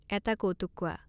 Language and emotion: Assamese, neutral